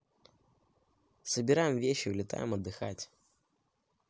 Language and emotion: Russian, neutral